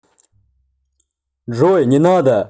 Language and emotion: Russian, neutral